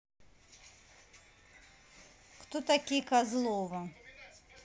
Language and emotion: Russian, neutral